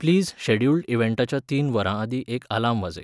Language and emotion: Goan Konkani, neutral